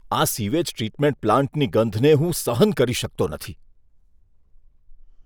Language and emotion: Gujarati, disgusted